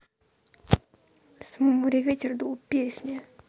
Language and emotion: Russian, neutral